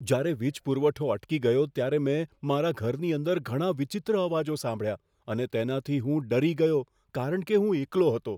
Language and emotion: Gujarati, fearful